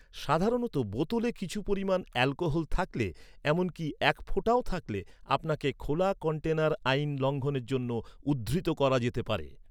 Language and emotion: Bengali, neutral